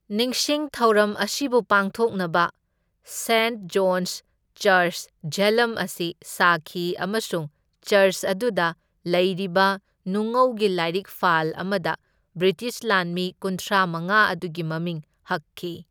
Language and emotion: Manipuri, neutral